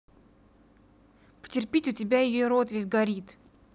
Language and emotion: Russian, angry